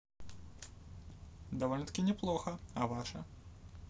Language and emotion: Russian, positive